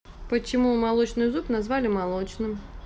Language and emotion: Russian, neutral